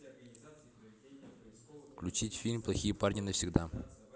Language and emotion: Russian, neutral